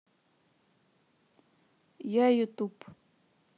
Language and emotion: Russian, neutral